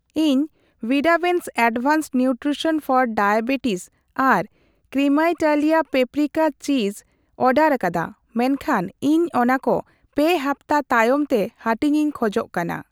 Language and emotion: Santali, neutral